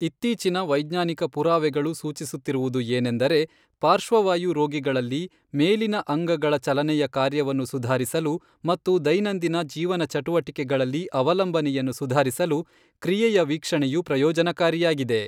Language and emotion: Kannada, neutral